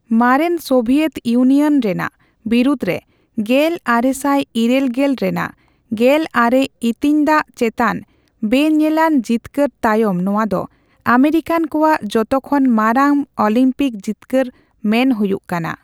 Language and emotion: Santali, neutral